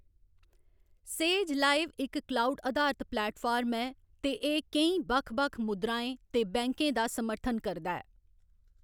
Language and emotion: Dogri, neutral